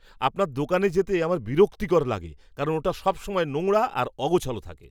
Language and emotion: Bengali, disgusted